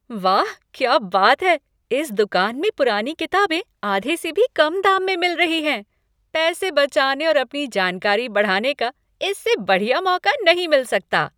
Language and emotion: Hindi, happy